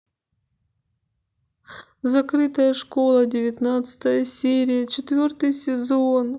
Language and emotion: Russian, sad